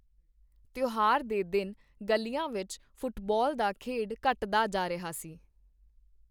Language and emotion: Punjabi, neutral